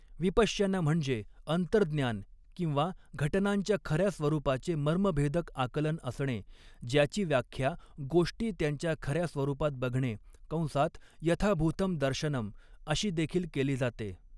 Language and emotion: Marathi, neutral